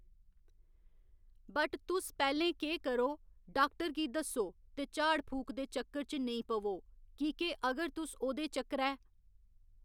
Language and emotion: Dogri, neutral